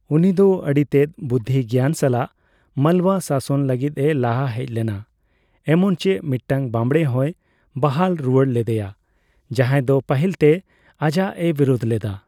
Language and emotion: Santali, neutral